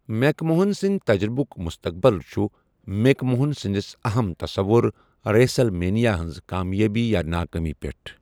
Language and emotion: Kashmiri, neutral